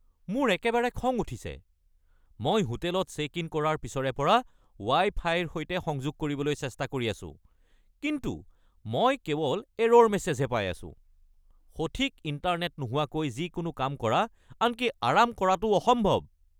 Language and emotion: Assamese, angry